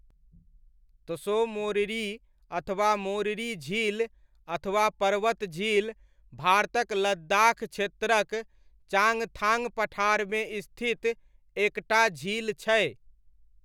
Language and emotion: Maithili, neutral